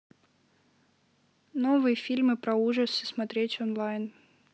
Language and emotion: Russian, neutral